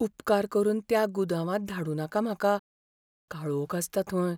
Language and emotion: Goan Konkani, fearful